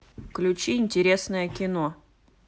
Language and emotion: Russian, neutral